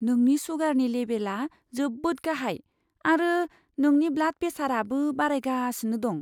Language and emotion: Bodo, fearful